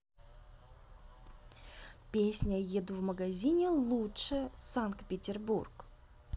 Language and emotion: Russian, neutral